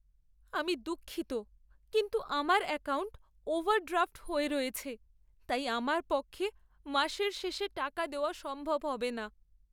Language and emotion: Bengali, sad